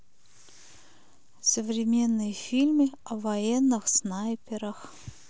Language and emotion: Russian, neutral